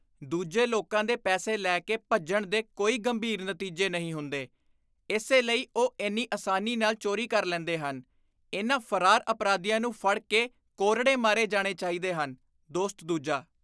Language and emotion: Punjabi, disgusted